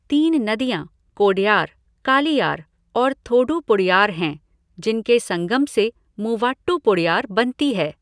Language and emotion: Hindi, neutral